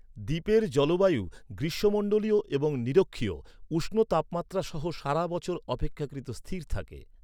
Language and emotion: Bengali, neutral